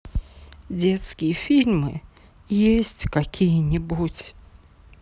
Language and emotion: Russian, sad